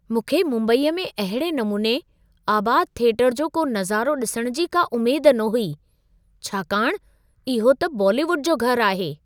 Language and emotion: Sindhi, surprised